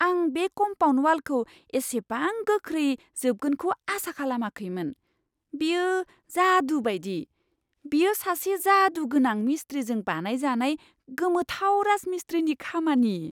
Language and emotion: Bodo, surprised